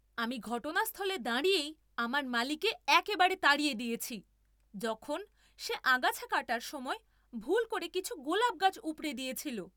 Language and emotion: Bengali, angry